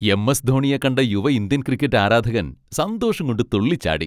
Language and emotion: Malayalam, happy